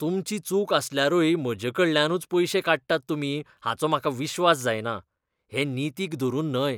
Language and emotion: Goan Konkani, disgusted